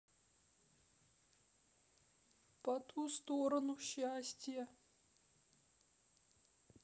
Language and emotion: Russian, sad